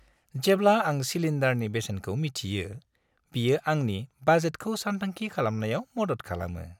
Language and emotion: Bodo, happy